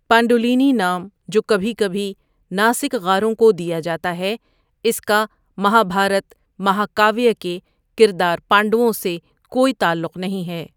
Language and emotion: Urdu, neutral